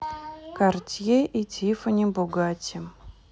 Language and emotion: Russian, neutral